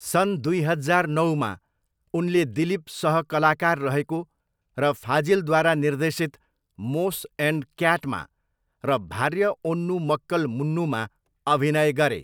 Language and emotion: Nepali, neutral